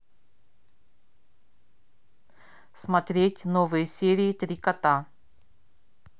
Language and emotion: Russian, neutral